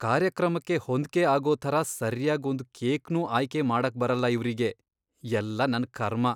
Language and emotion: Kannada, disgusted